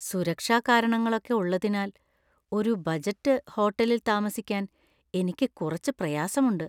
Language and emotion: Malayalam, fearful